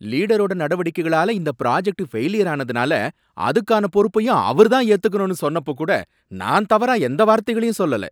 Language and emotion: Tamil, angry